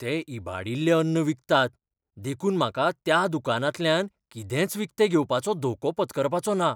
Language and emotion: Goan Konkani, fearful